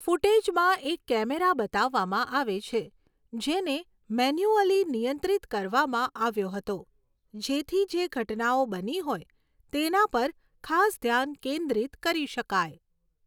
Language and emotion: Gujarati, neutral